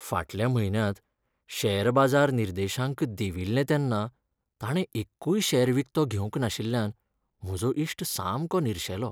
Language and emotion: Goan Konkani, sad